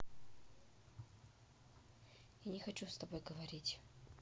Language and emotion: Russian, sad